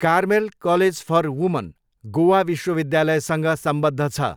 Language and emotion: Nepali, neutral